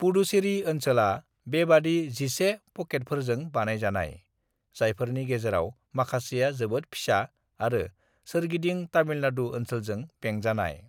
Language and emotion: Bodo, neutral